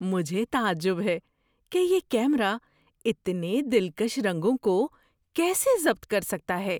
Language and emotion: Urdu, surprised